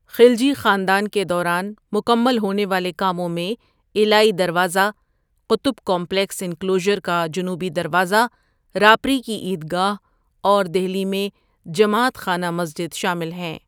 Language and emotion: Urdu, neutral